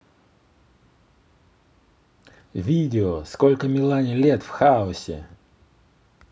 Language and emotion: Russian, positive